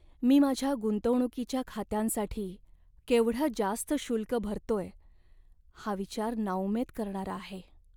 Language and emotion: Marathi, sad